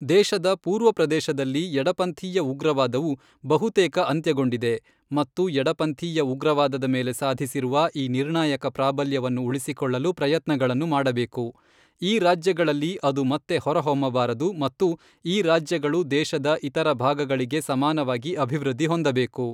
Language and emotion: Kannada, neutral